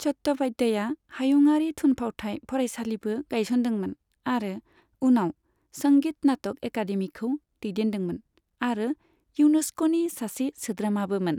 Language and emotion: Bodo, neutral